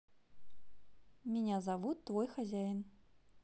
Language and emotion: Russian, neutral